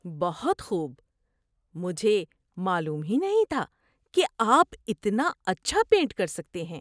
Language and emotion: Urdu, surprised